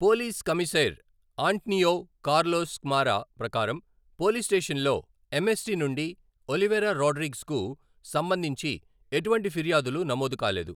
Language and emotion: Telugu, neutral